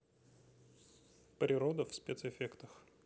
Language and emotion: Russian, neutral